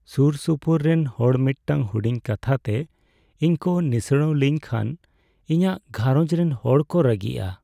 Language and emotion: Santali, sad